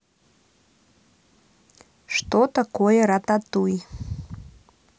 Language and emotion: Russian, neutral